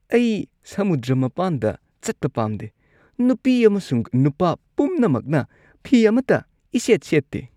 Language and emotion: Manipuri, disgusted